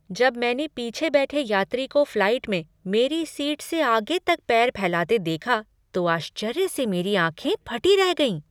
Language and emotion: Hindi, surprised